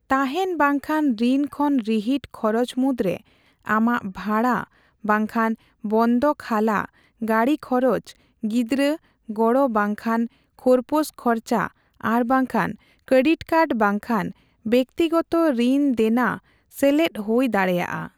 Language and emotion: Santali, neutral